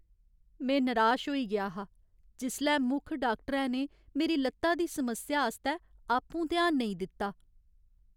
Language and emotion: Dogri, sad